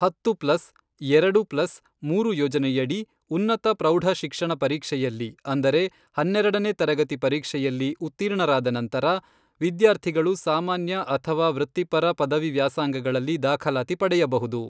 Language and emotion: Kannada, neutral